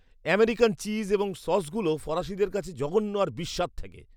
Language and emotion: Bengali, disgusted